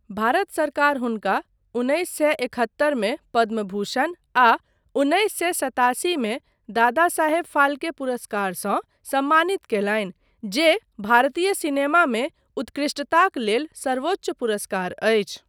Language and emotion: Maithili, neutral